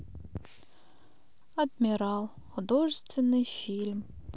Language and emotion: Russian, sad